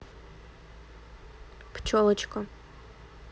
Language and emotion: Russian, neutral